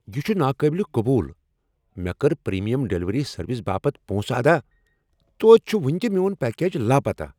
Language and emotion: Kashmiri, angry